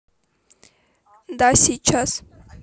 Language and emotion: Russian, neutral